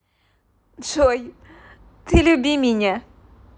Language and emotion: Russian, positive